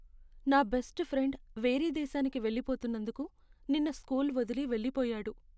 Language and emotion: Telugu, sad